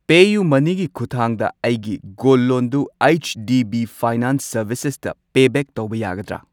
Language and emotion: Manipuri, neutral